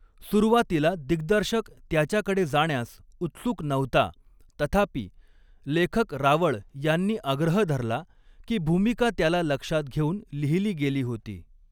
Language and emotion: Marathi, neutral